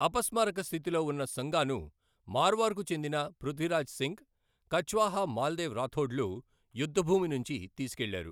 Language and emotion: Telugu, neutral